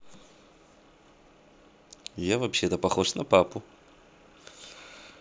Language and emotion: Russian, neutral